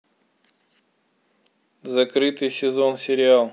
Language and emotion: Russian, neutral